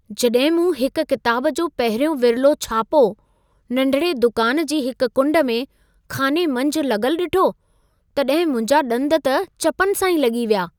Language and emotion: Sindhi, surprised